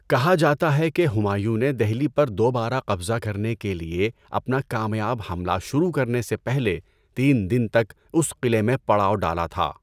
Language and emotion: Urdu, neutral